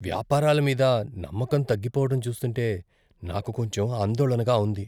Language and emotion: Telugu, fearful